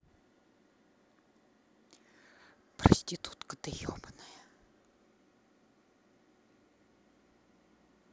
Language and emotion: Russian, angry